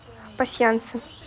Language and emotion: Russian, neutral